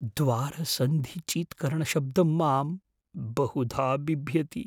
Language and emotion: Sanskrit, fearful